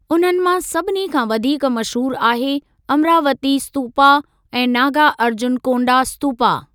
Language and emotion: Sindhi, neutral